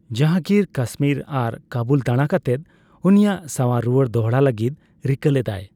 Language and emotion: Santali, neutral